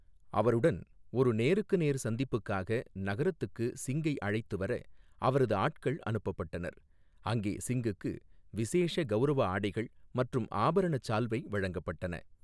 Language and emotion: Tamil, neutral